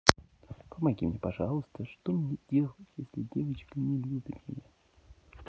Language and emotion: Russian, neutral